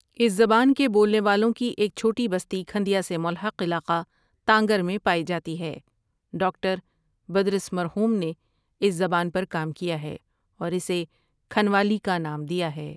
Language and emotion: Urdu, neutral